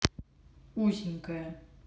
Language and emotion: Russian, neutral